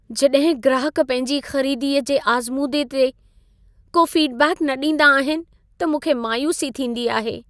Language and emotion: Sindhi, sad